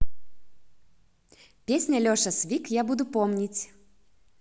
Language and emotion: Russian, positive